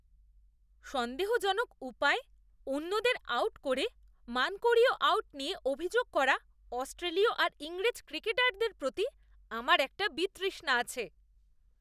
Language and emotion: Bengali, disgusted